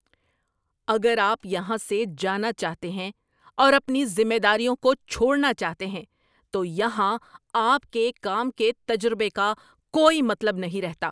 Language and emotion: Urdu, angry